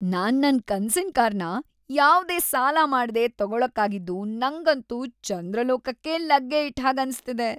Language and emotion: Kannada, happy